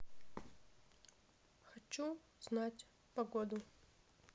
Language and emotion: Russian, neutral